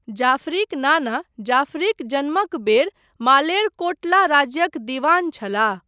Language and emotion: Maithili, neutral